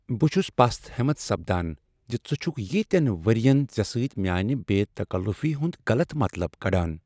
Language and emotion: Kashmiri, sad